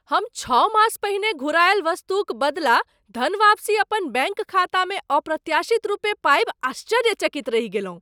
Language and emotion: Maithili, surprised